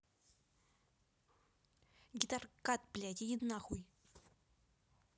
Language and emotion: Russian, angry